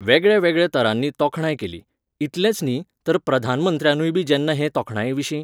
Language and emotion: Goan Konkani, neutral